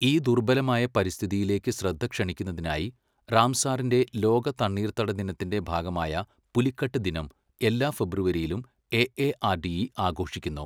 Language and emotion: Malayalam, neutral